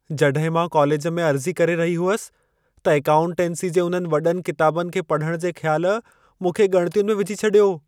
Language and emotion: Sindhi, fearful